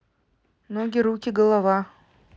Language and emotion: Russian, neutral